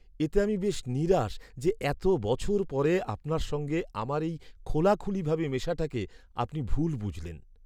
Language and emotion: Bengali, sad